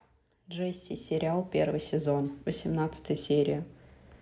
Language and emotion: Russian, neutral